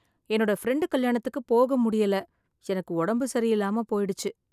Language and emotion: Tamil, sad